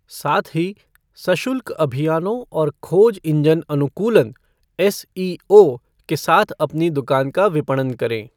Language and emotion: Hindi, neutral